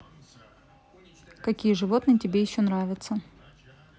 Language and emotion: Russian, neutral